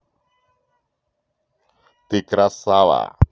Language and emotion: Russian, positive